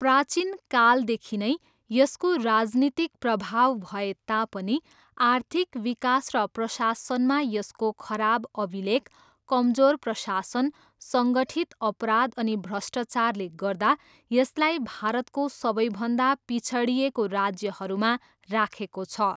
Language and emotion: Nepali, neutral